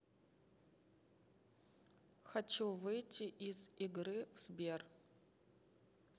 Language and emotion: Russian, neutral